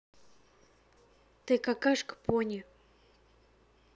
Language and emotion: Russian, neutral